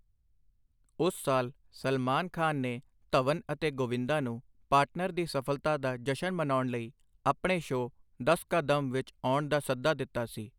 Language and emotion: Punjabi, neutral